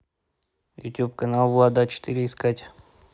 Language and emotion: Russian, neutral